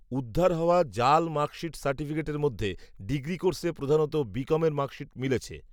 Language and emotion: Bengali, neutral